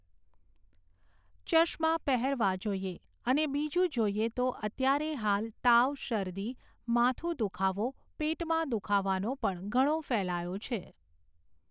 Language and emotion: Gujarati, neutral